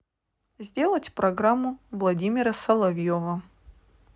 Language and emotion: Russian, neutral